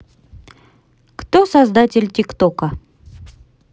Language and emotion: Russian, neutral